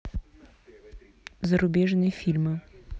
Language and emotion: Russian, neutral